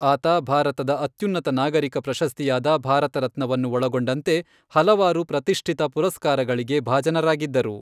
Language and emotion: Kannada, neutral